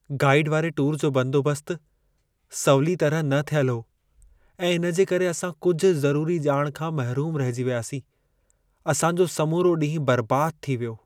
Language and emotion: Sindhi, sad